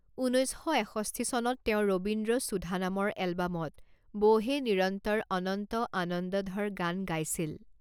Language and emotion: Assamese, neutral